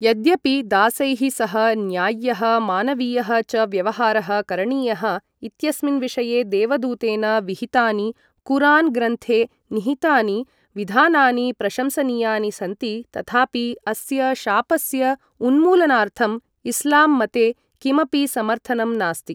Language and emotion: Sanskrit, neutral